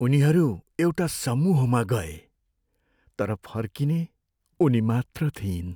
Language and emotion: Nepali, sad